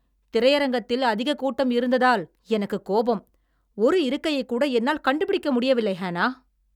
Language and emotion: Tamil, angry